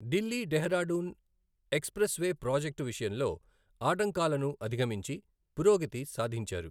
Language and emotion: Telugu, neutral